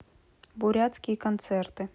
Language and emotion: Russian, neutral